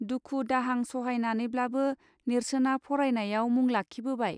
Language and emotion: Bodo, neutral